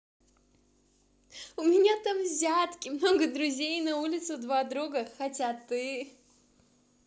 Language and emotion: Russian, positive